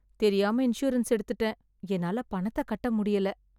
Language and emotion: Tamil, sad